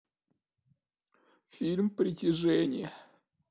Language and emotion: Russian, sad